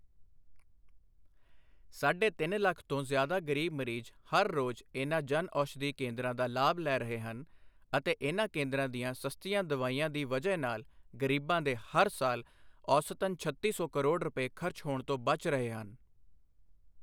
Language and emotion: Punjabi, neutral